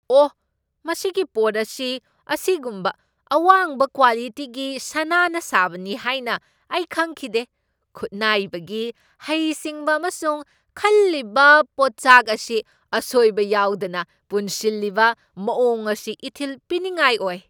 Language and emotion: Manipuri, surprised